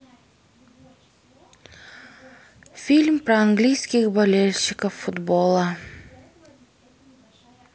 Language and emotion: Russian, sad